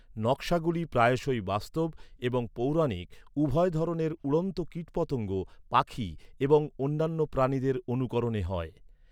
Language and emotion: Bengali, neutral